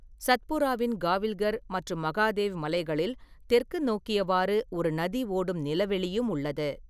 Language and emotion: Tamil, neutral